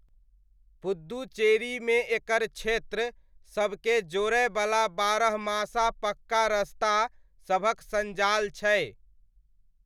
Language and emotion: Maithili, neutral